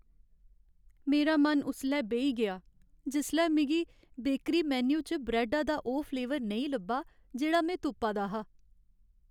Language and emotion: Dogri, sad